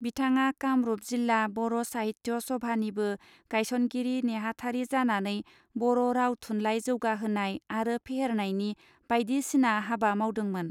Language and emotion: Bodo, neutral